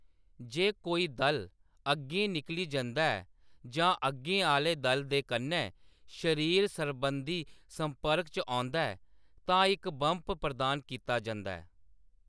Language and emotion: Dogri, neutral